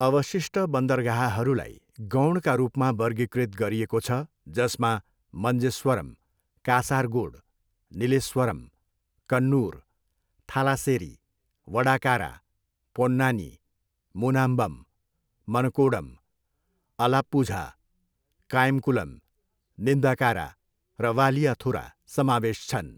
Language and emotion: Nepali, neutral